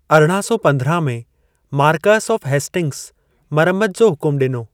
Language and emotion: Sindhi, neutral